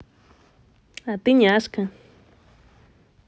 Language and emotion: Russian, positive